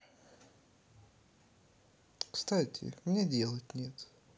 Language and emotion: Russian, neutral